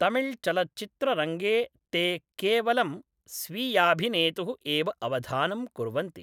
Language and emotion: Sanskrit, neutral